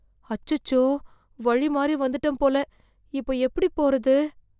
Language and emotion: Tamil, fearful